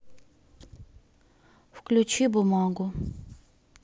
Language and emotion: Russian, sad